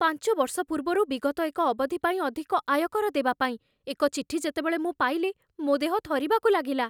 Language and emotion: Odia, fearful